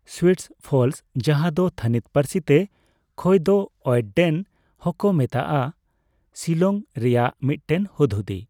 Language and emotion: Santali, neutral